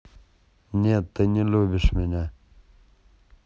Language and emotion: Russian, neutral